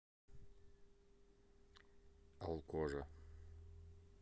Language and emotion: Russian, neutral